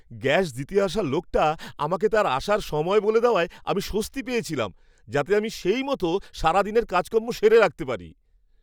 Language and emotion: Bengali, happy